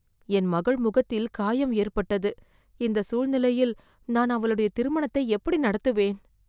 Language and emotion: Tamil, fearful